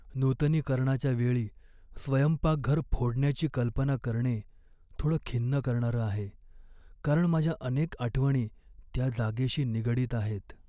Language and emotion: Marathi, sad